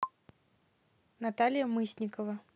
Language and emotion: Russian, neutral